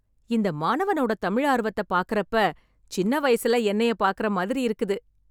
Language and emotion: Tamil, happy